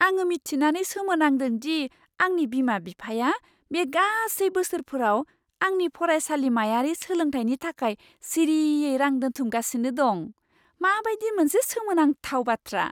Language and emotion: Bodo, surprised